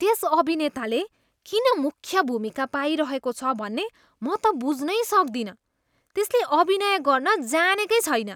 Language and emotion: Nepali, disgusted